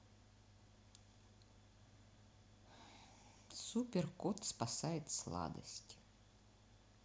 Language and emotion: Russian, neutral